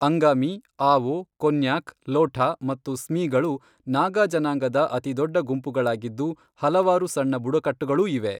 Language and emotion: Kannada, neutral